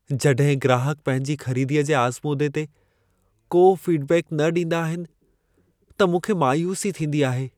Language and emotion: Sindhi, sad